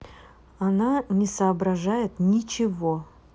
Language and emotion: Russian, neutral